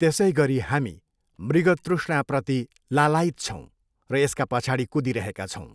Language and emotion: Nepali, neutral